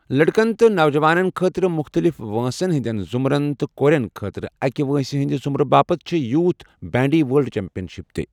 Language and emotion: Kashmiri, neutral